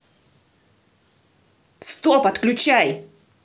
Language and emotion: Russian, angry